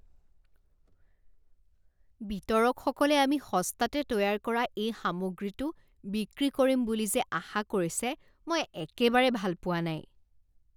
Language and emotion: Assamese, disgusted